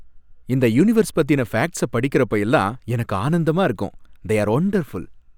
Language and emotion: Tamil, happy